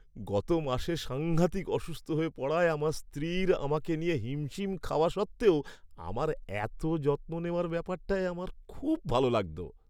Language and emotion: Bengali, happy